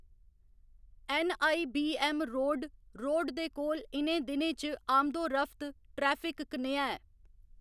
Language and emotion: Dogri, neutral